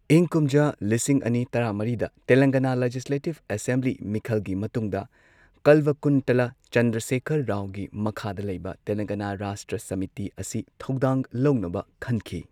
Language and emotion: Manipuri, neutral